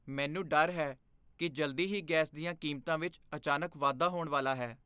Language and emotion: Punjabi, fearful